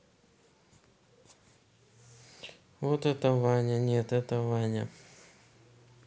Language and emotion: Russian, neutral